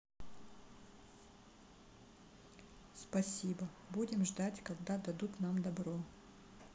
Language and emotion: Russian, neutral